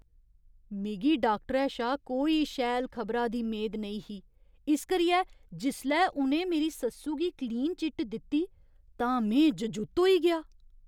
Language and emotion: Dogri, surprised